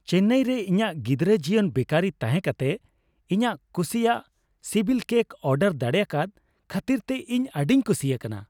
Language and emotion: Santali, happy